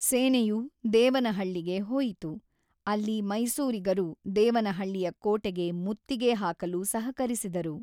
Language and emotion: Kannada, neutral